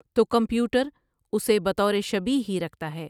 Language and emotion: Urdu, neutral